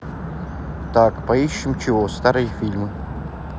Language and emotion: Russian, neutral